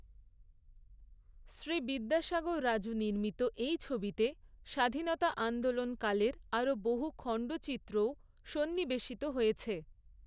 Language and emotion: Bengali, neutral